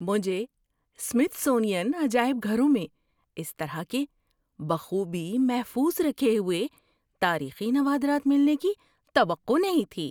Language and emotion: Urdu, surprised